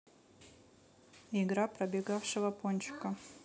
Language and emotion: Russian, neutral